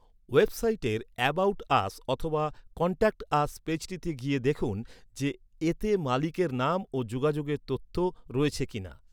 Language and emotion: Bengali, neutral